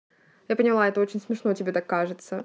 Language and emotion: Russian, angry